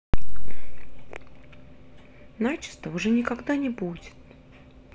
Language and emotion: Russian, neutral